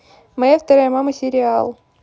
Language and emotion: Russian, neutral